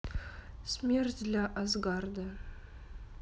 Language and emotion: Russian, sad